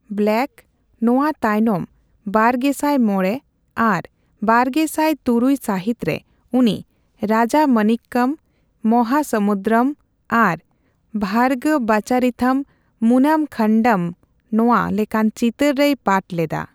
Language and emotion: Santali, neutral